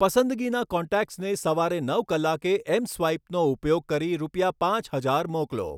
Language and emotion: Gujarati, neutral